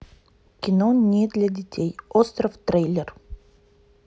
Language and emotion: Russian, neutral